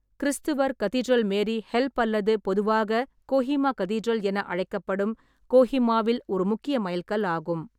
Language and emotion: Tamil, neutral